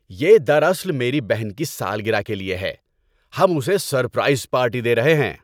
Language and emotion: Urdu, happy